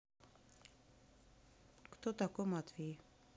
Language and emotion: Russian, sad